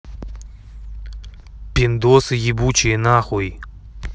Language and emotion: Russian, angry